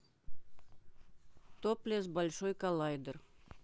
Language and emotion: Russian, neutral